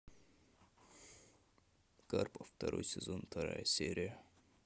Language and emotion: Russian, neutral